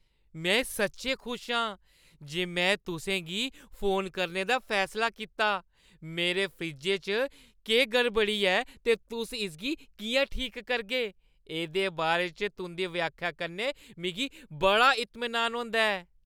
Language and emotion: Dogri, happy